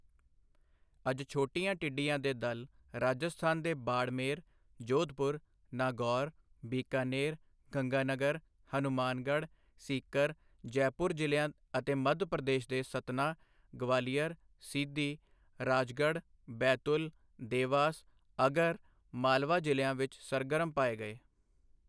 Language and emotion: Punjabi, neutral